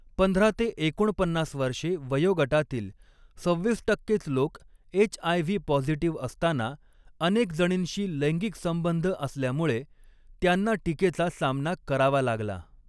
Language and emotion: Marathi, neutral